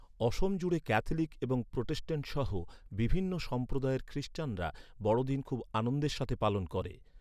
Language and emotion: Bengali, neutral